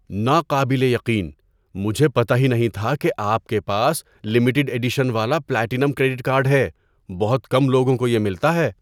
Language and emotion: Urdu, surprised